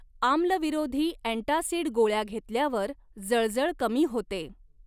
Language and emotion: Marathi, neutral